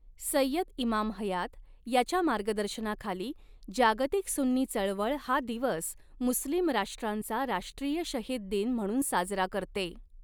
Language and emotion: Marathi, neutral